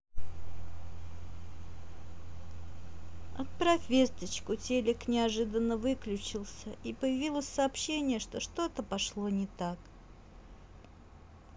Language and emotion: Russian, sad